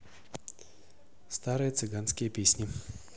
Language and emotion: Russian, neutral